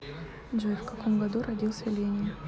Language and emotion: Russian, neutral